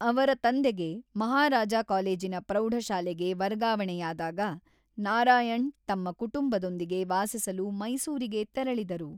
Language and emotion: Kannada, neutral